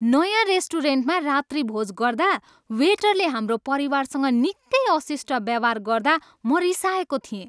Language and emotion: Nepali, angry